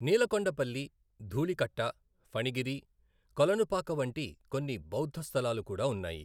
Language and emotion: Telugu, neutral